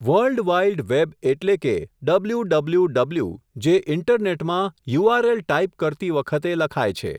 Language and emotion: Gujarati, neutral